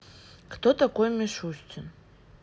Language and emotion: Russian, sad